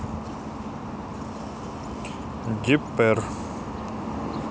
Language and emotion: Russian, neutral